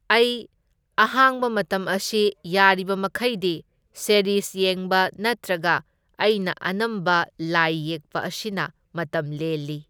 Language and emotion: Manipuri, neutral